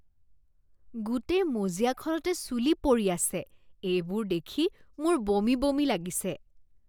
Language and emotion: Assamese, disgusted